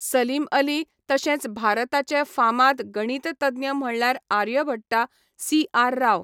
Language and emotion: Goan Konkani, neutral